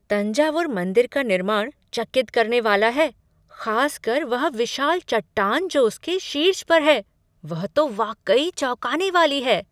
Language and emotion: Hindi, surprised